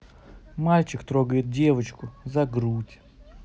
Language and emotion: Russian, neutral